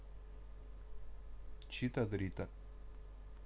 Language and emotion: Russian, neutral